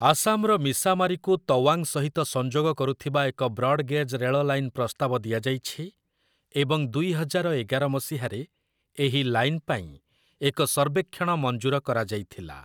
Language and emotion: Odia, neutral